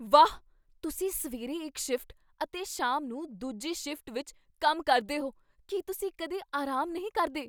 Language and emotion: Punjabi, surprised